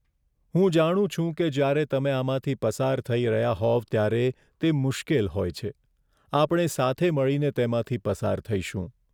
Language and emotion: Gujarati, sad